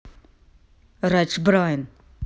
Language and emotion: Russian, angry